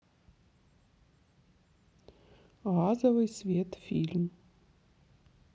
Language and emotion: Russian, neutral